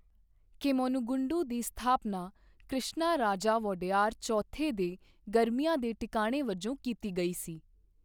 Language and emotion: Punjabi, neutral